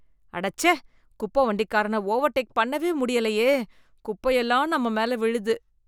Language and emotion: Tamil, disgusted